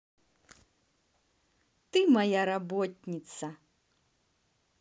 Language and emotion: Russian, positive